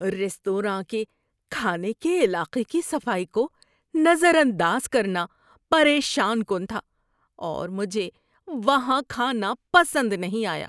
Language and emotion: Urdu, disgusted